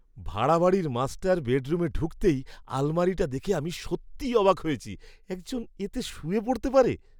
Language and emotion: Bengali, surprised